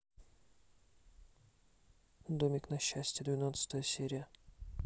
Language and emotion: Russian, neutral